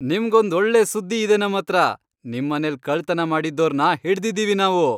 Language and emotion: Kannada, happy